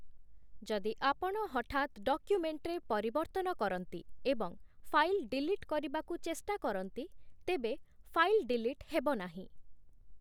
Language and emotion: Odia, neutral